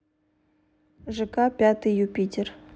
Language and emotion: Russian, neutral